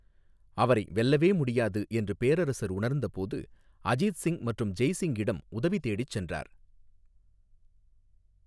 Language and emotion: Tamil, neutral